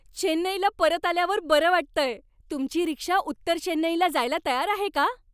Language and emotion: Marathi, happy